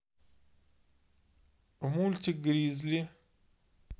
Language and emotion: Russian, neutral